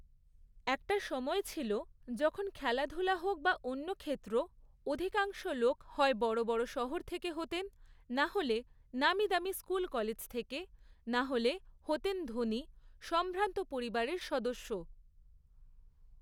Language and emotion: Bengali, neutral